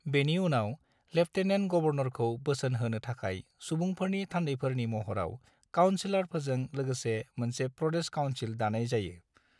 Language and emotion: Bodo, neutral